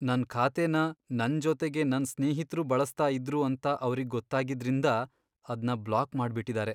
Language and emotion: Kannada, sad